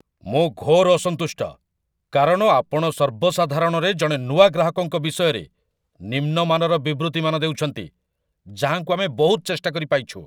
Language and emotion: Odia, angry